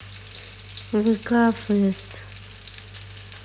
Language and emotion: Russian, neutral